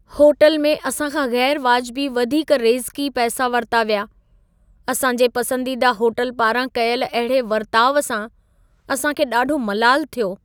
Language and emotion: Sindhi, sad